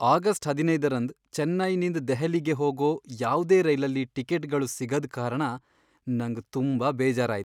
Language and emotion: Kannada, sad